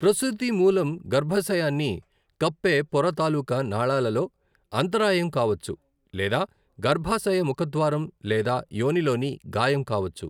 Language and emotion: Telugu, neutral